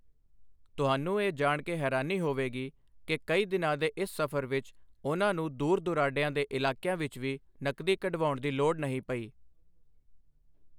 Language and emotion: Punjabi, neutral